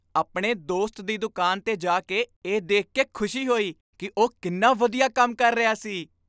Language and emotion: Punjabi, happy